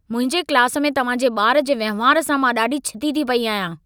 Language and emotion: Sindhi, angry